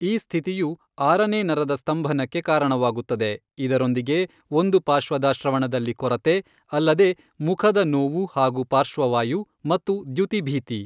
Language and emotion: Kannada, neutral